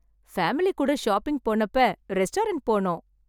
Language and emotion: Tamil, happy